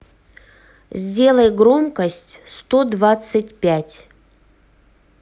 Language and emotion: Russian, neutral